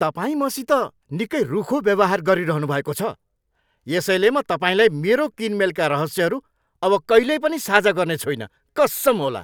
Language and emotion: Nepali, angry